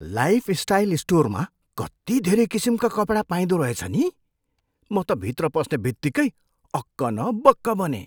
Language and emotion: Nepali, surprised